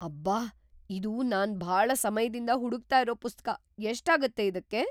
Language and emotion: Kannada, surprised